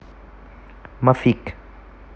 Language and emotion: Russian, neutral